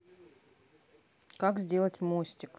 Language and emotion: Russian, neutral